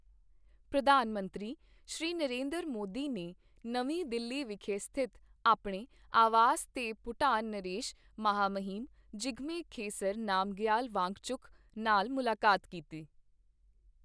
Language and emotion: Punjabi, neutral